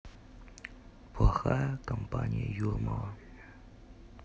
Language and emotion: Russian, neutral